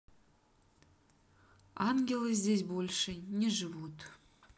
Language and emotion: Russian, sad